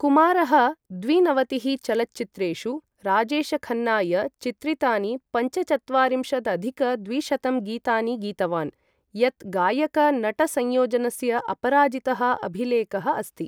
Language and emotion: Sanskrit, neutral